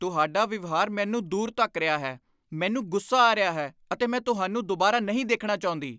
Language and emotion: Punjabi, angry